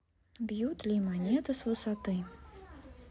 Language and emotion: Russian, neutral